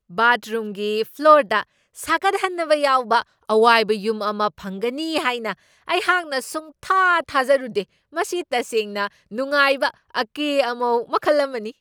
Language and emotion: Manipuri, surprised